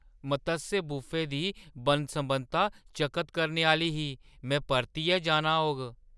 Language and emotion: Dogri, surprised